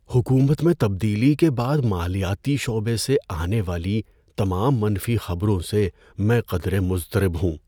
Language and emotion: Urdu, fearful